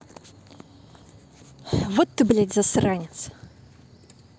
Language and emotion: Russian, angry